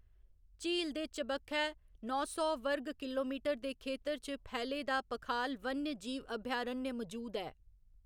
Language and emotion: Dogri, neutral